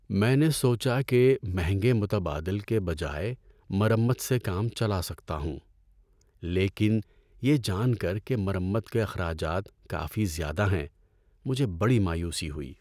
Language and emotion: Urdu, sad